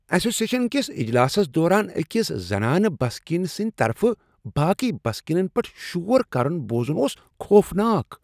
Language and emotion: Kashmiri, disgusted